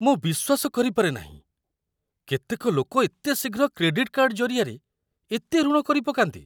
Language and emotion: Odia, surprised